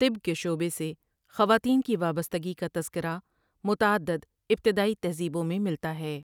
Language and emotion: Urdu, neutral